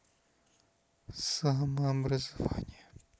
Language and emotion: Russian, neutral